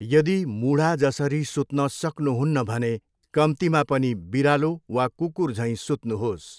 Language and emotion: Nepali, neutral